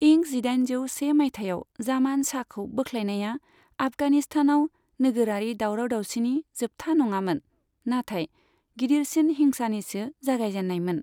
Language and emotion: Bodo, neutral